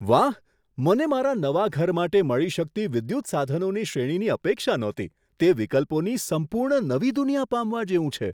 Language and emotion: Gujarati, surprised